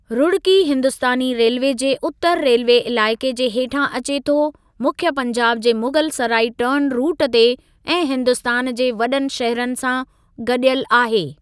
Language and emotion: Sindhi, neutral